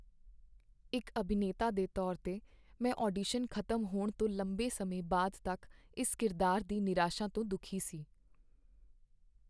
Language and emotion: Punjabi, sad